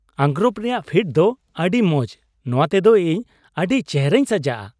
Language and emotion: Santali, happy